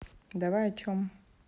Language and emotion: Russian, neutral